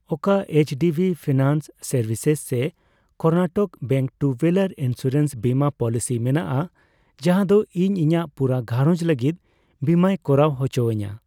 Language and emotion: Santali, neutral